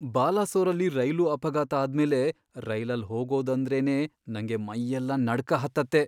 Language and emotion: Kannada, fearful